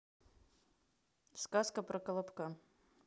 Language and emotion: Russian, neutral